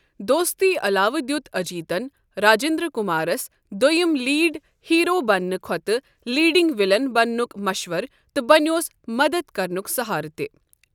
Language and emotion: Kashmiri, neutral